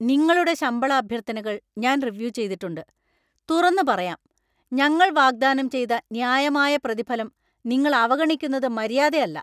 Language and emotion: Malayalam, angry